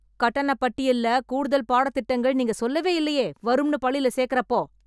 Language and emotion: Tamil, angry